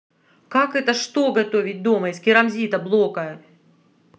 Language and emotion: Russian, angry